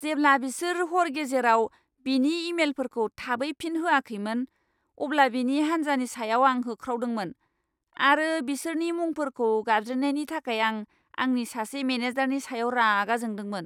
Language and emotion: Bodo, angry